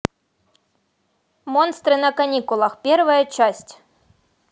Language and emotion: Russian, neutral